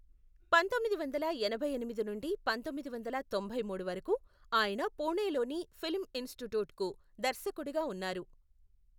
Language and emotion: Telugu, neutral